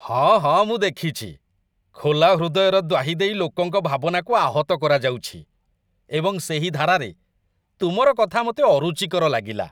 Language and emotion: Odia, disgusted